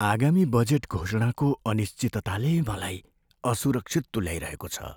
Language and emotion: Nepali, fearful